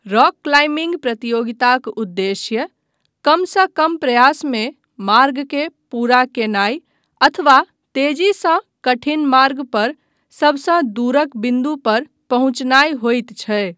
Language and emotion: Maithili, neutral